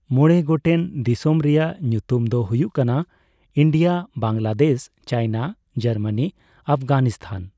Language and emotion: Santali, neutral